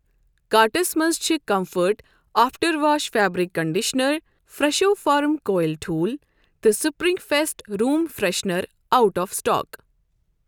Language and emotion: Kashmiri, neutral